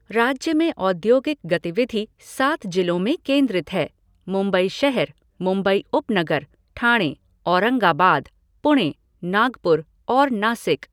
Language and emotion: Hindi, neutral